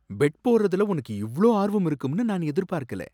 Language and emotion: Tamil, surprised